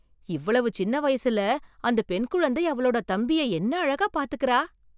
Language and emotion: Tamil, surprised